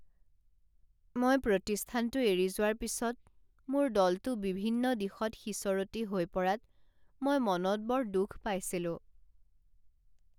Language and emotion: Assamese, sad